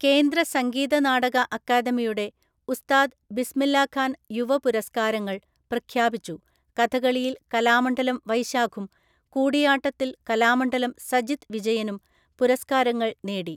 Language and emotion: Malayalam, neutral